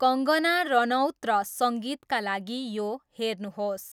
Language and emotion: Nepali, neutral